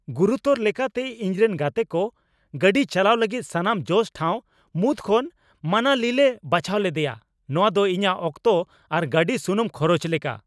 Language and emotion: Santali, angry